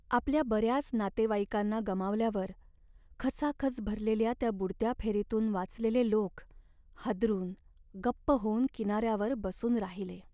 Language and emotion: Marathi, sad